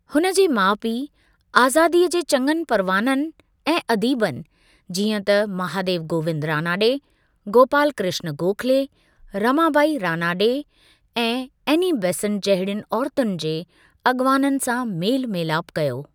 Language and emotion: Sindhi, neutral